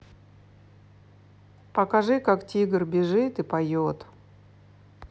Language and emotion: Russian, neutral